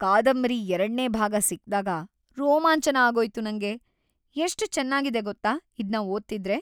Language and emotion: Kannada, happy